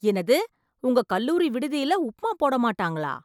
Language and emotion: Tamil, surprised